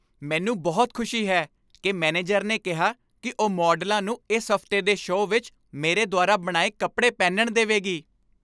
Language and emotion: Punjabi, happy